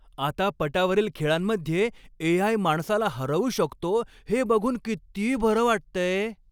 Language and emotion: Marathi, happy